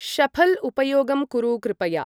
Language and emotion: Sanskrit, neutral